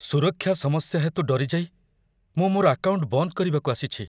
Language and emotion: Odia, fearful